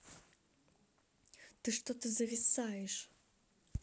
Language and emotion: Russian, angry